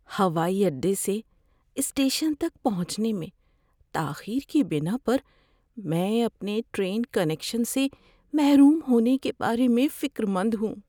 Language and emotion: Urdu, fearful